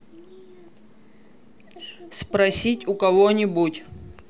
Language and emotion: Russian, neutral